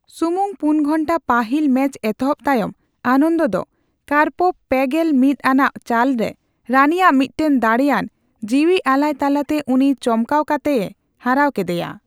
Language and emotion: Santali, neutral